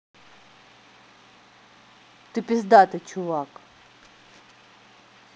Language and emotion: Russian, neutral